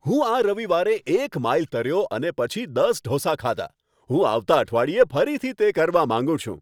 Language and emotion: Gujarati, happy